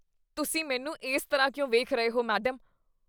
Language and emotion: Punjabi, disgusted